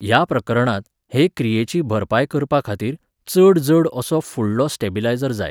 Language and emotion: Goan Konkani, neutral